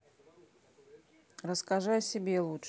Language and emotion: Russian, neutral